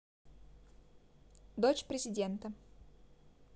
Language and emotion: Russian, neutral